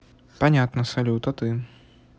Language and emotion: Russian, neutral